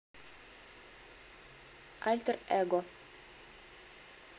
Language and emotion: Russian, neutral